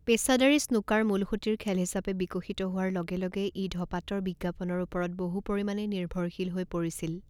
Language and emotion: Assamese, neutral